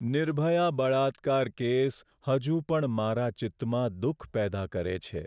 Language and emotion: Gujarati, sad